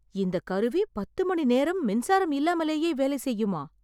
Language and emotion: Tamil, surprised